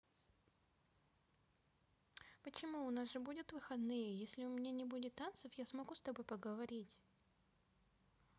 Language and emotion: Russian, neutral